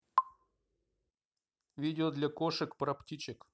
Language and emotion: Russian, neutral